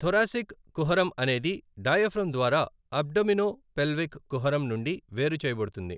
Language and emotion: Telugu, neutral